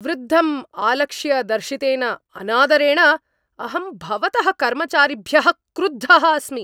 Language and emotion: Sanskrit, angry